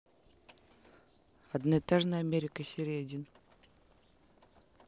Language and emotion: Russian, neutral